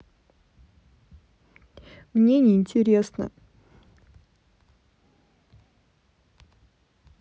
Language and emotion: Russian, sad